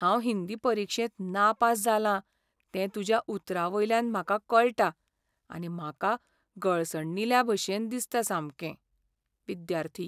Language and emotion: Goan Konkani, sad